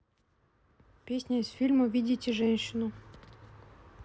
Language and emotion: Russian, neutral